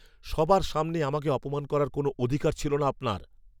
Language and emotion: Bengali, angry